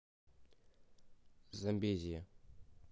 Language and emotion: Russian, neutral